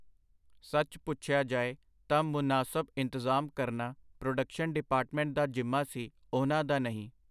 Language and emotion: Punjabi, neutral